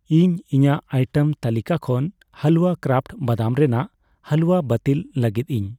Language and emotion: Santali, neutral